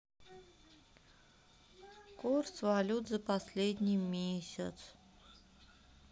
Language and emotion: Russian, sad